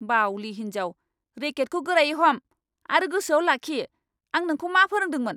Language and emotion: Bodo, angry